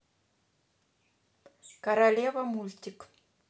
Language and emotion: Russian, neutral